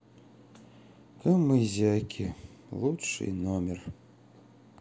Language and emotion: Russian, sad